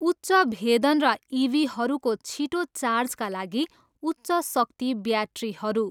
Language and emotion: Nepali, neutral